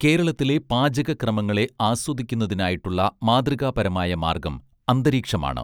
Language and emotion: Malayalam, neutral